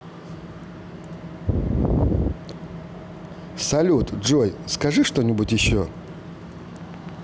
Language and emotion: Russian, positive